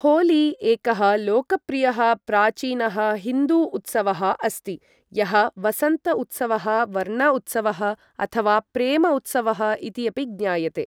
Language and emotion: Sanskrit, neutral